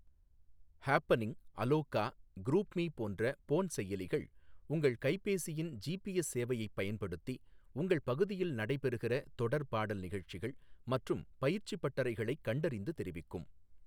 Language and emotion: Tamil, neutral